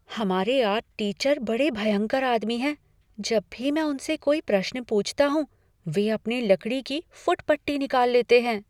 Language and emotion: Hindi, fearful